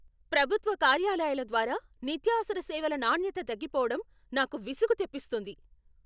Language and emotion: Telugu, angry